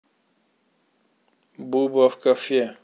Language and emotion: Russian, neutral